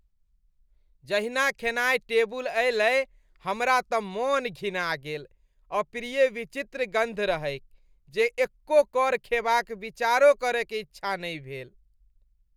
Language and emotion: Maithili, disgusted